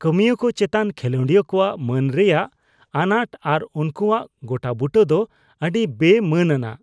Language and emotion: Santali, disgusted